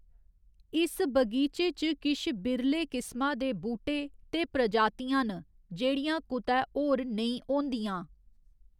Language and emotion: Dogri, neutral